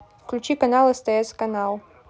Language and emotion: Russian, neutral